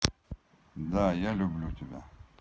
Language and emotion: Russian, neutral